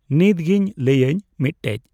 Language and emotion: Santali, neutral